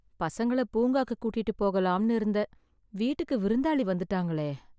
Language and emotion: Tamil, sad